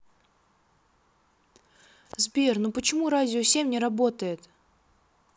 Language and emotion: Russian, sad